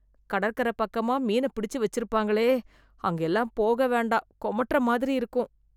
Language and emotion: Tamil, disgusted